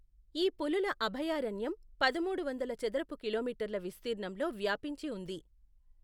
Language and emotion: Telugu, neutral